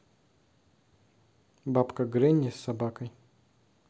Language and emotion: Russian, neutral